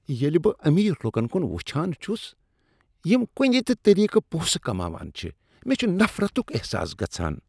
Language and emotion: Kashmiri, disgusted